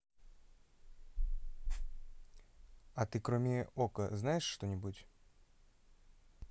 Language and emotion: Russian, neutral